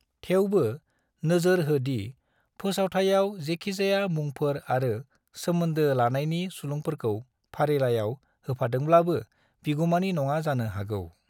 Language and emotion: Bodo, neutral